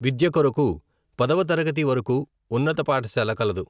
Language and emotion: Telugu, neutral